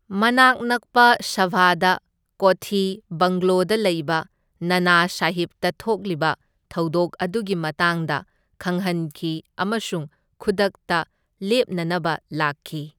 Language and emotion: Manipuri, neutral